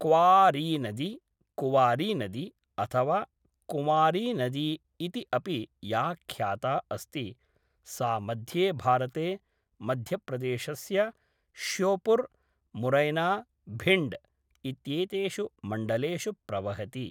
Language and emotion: Sanskrit, neutral